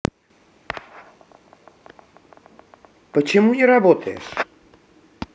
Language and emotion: Russian, neutral